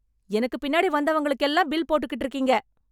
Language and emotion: Tamil, angry